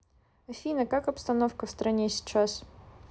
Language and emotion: Russian, neutral